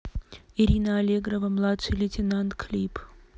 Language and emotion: Russian, neutral